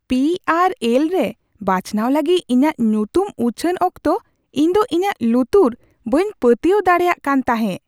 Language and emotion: Santali, surprised